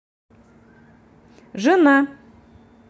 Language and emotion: Russian, neutral